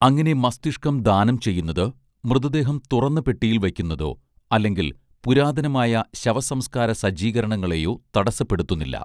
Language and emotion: Malayalam, neutral